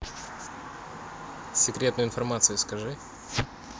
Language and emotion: Russian, neutral